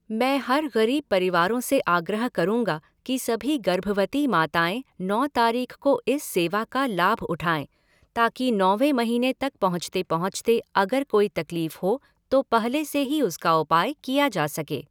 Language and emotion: Hindi, neutral